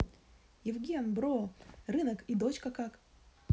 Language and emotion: Russian, positive